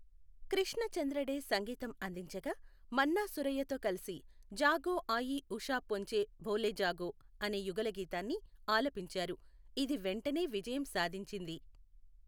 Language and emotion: Telugu, neutral